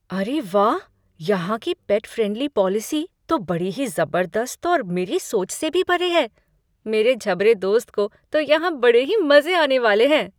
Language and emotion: Hindi, surprised